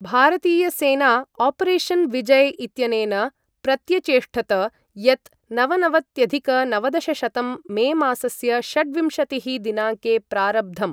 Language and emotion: Sanskrit, neutral